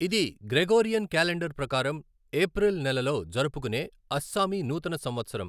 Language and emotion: Telugu, neutral